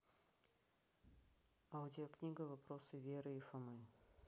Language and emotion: Russian, neutral